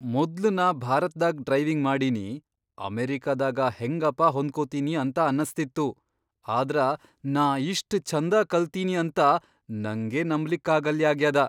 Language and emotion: Kannada, surprised